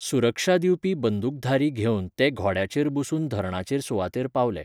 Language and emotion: Goan Konkani, neutral